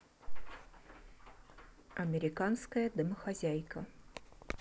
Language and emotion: Russian, neutral